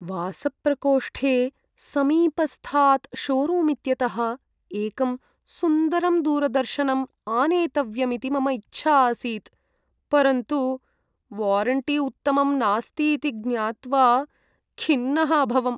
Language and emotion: Sanskrit, sad